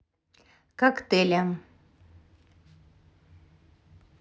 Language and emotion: Russian, neutral